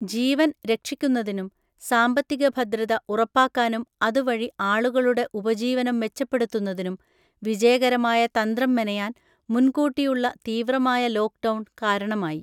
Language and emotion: Malayalam, neutral